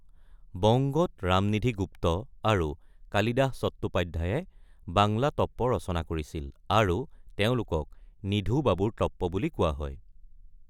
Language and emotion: Assamese, neutral